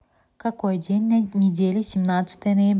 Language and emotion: Russian, neutral